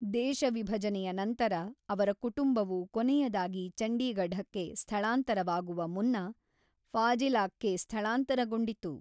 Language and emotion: Kannada, neutral